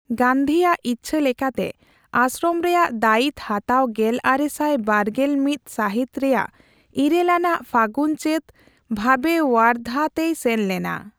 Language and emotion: Santali, neutral